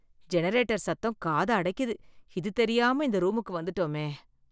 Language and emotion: Tamil, disgusted